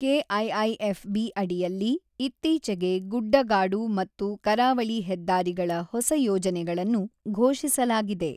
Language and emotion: Kannada, neutral